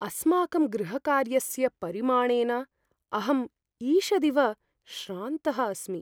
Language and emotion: Sanskrit, fearful